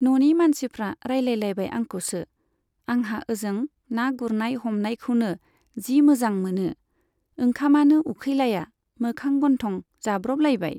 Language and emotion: Bodo, neutral